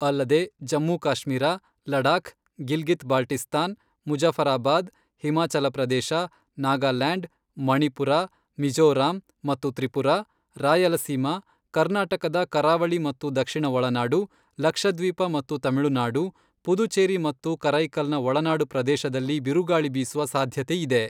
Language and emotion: Kannada, neutral